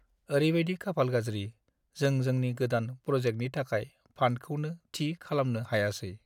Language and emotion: Bodo, sad